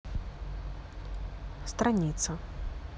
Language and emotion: Russian, neutral